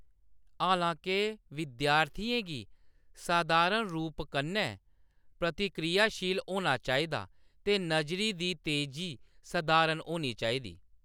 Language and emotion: Dogri, neutral